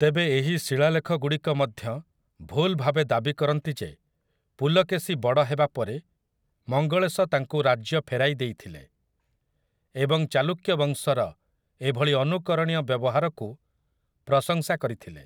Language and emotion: Odia, neutral